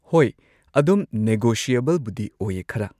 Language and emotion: Manipuri, neutral